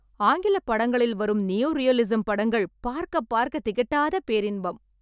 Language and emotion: Tamil, happy